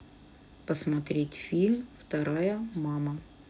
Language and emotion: Russian, neutral